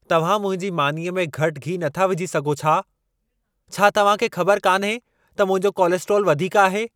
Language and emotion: Sindhi, angry